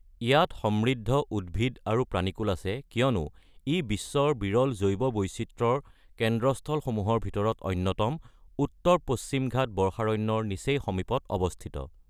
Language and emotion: Assamese, neutral